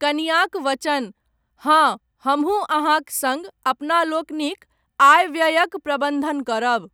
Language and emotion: Maithili, neutral